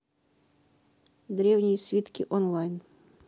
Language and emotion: Russian, neutral